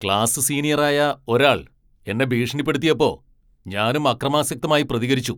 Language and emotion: Malayalam, angry